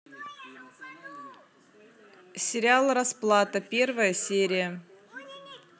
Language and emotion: Russian, neutral